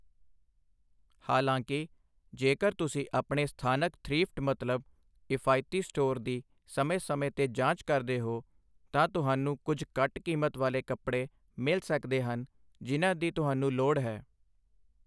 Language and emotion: Punjabi, neutral